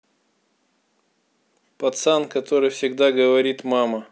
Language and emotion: Russian, neutral